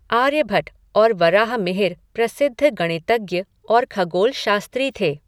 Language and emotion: Hindi, neutral